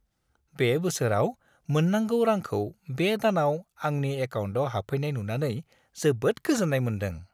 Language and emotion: Bodo, happy